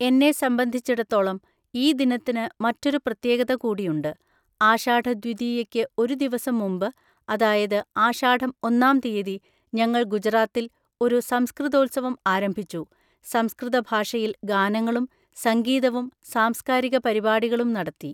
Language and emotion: Malayalam, neutral